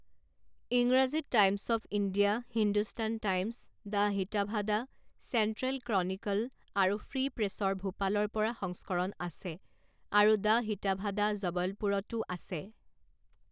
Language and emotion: Assamese, neutral